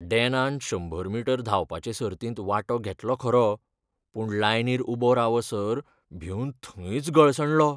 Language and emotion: Goan Konkani, fearful